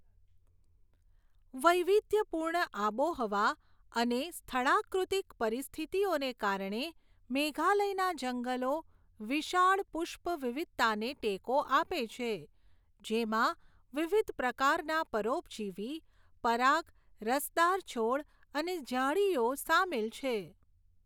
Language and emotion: Gujarati, neutral